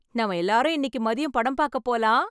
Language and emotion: Tamil, happy